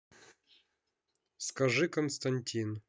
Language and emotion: Russian, neutral